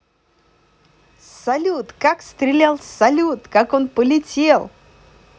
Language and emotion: Russian, positive